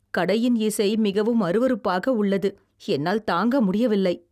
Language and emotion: Tamil, disgusted